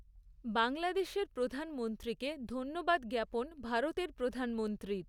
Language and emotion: Bengali, neutral